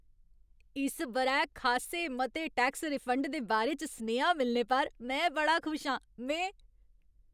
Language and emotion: Dogri, happy